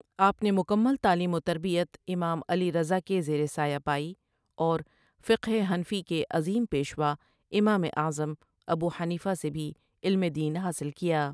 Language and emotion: Urdu, neutral